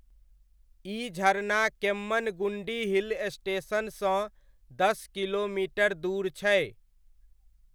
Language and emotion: Maithili, neutral